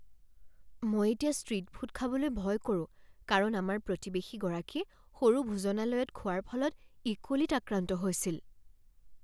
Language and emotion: Assamese, fearful